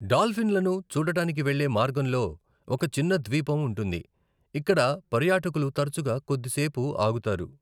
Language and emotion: Telugu, neutral